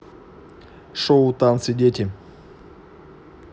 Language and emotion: Russian, neutral